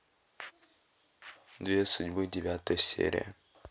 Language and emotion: Russian, neutral